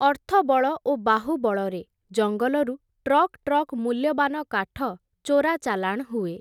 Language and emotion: Odia, neutral